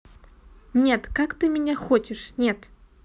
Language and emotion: Russian, neutral